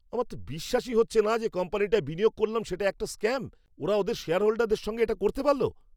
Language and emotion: Bengali, angry